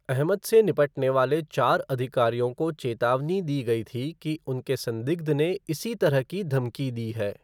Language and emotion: Hindi, neutral